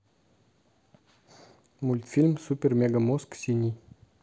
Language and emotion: Russian, neutral